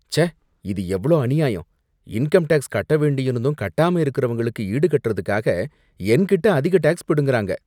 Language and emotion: Tamil, disgusted